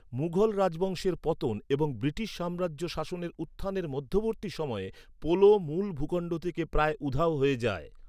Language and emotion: Bengali, neutral